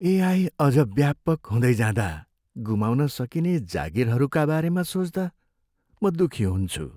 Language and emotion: Nepali, sad